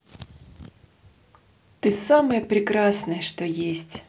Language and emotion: Russian, positive